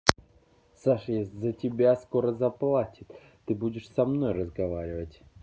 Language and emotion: Russian, angry